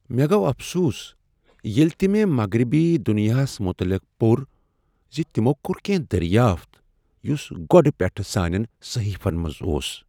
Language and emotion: Kashmiri, sad